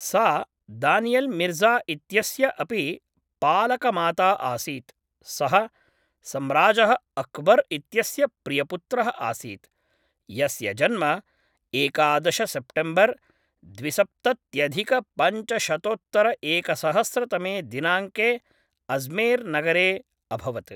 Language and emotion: Sanskrit, neutral